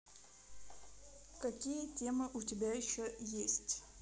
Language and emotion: Russian, neutral